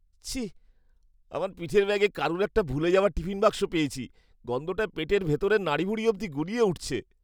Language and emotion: Bengali, disgusted